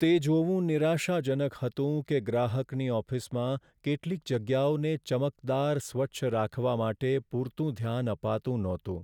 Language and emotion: Gujarati, sad